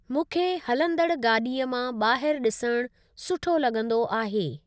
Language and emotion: Sindhi, neutral